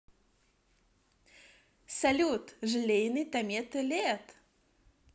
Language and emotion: Russian, positive